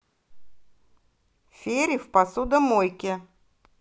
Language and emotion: Russian, neutral